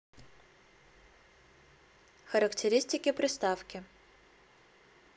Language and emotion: Russian, neutral